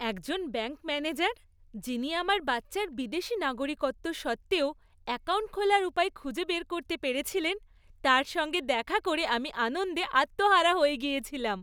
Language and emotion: Bengali, happy